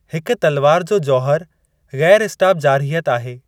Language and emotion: Sindhi, neutral